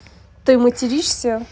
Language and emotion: Russian, neutral